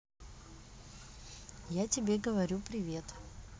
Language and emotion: Russian, neutral